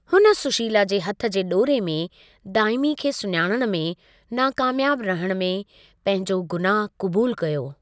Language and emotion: Sindhi, neutral